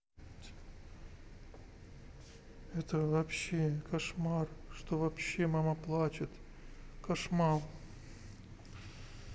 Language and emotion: Russian, sad